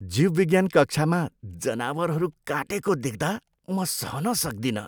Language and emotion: Nepali, disgusted